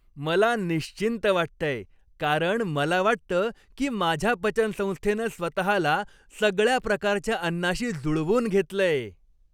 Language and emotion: Marathi, happy